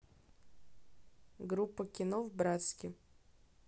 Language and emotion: Russian, neutral